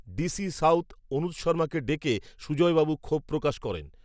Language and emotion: Bengali, neutral